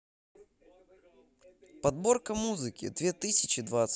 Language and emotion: Russian, positive